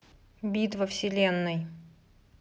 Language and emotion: Russian, neutral